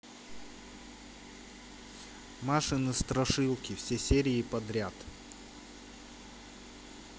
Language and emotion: Russian, neutral